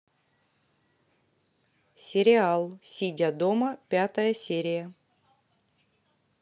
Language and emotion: Russian, neutral